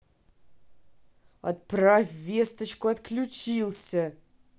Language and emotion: Russian, angry